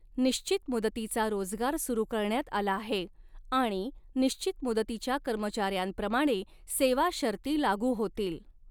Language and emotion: Marathi, neutral